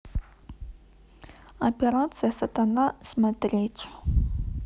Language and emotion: Russian, neutral